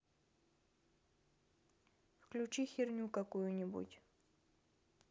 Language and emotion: Russian, neutral